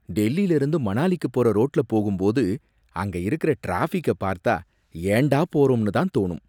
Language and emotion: Tamil, disgusted